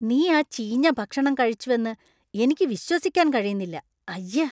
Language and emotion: Malayalam, disgusted